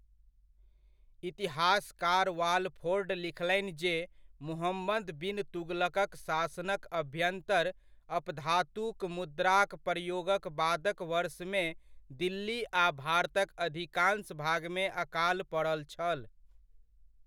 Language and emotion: Maithili, neutral